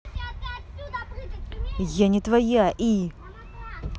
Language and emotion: Russian, angry